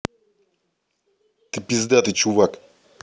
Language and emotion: Russian, angry